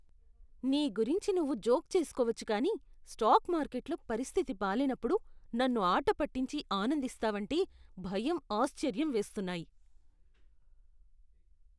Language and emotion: Telugu, disgusted